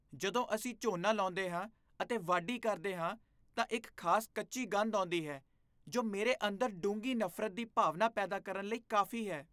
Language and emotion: Punjabi, disgusted